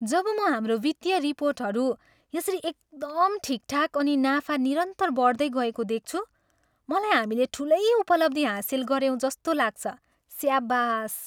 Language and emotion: Nepali, happy